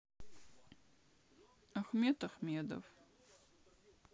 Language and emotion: Russian, neutral